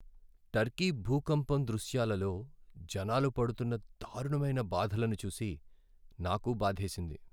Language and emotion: Telugu, sad